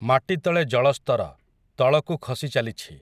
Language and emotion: Odia, neutral